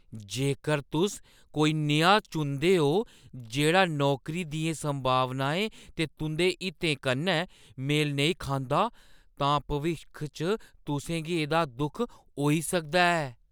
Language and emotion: Dogri, fearful